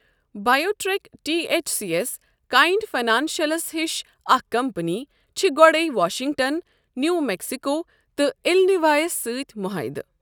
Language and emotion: Kashmiri, neutral